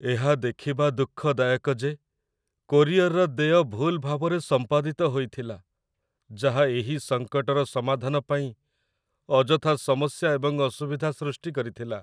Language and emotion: Odia, sad